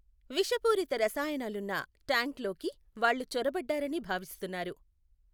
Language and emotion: Telugu, neutral